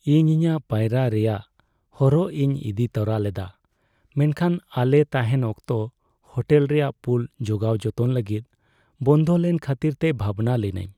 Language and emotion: Santali, sad